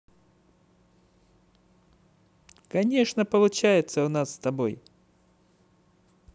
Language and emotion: Russian, positive